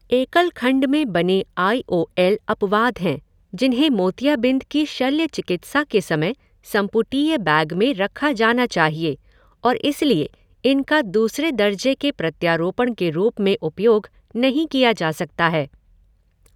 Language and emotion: Hindi, neutral